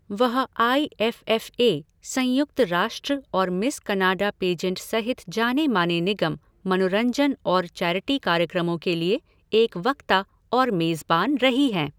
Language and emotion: Hindi, neutral